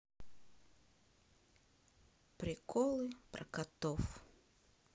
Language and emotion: Russian, sad